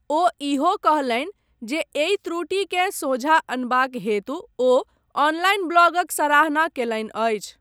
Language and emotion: Maithili, neutral